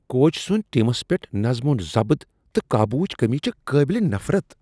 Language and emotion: Kashmiri, disgusted